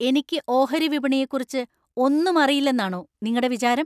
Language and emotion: Malayalam, angry